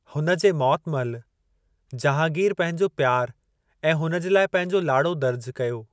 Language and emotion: Sindhi, neutral